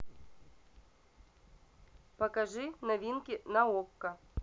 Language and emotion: Russian, neutral